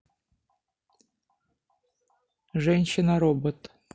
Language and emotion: Russian, neutral